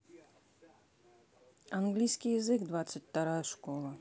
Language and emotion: Russian, neutral